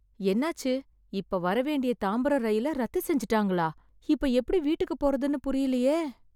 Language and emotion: Tamil, sad